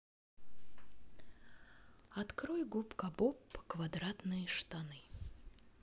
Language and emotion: Russian, sad